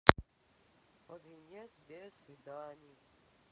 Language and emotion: Russian, sad